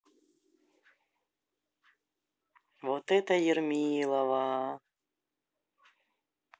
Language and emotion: Russian, neutral